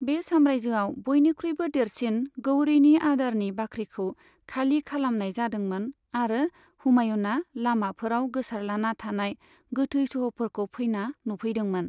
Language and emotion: Bodo, neutral